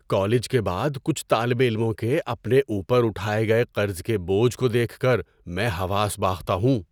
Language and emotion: Urdu, surprised